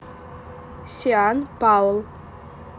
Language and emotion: Russian, neutral